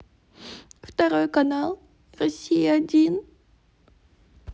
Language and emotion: Russian, sad